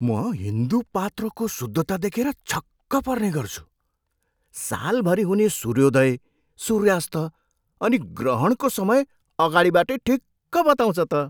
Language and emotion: Nepali, surprised